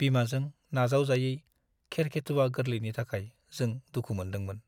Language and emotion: Bodo, sad